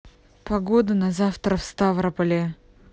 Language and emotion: Russian, neutral